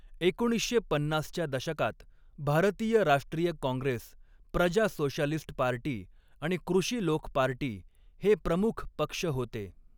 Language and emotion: Marathi, neutral